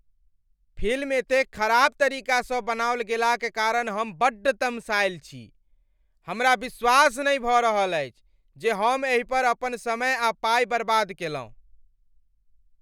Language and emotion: Maithili, angry